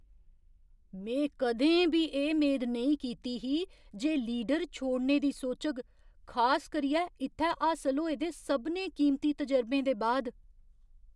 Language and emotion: Dogri, surprised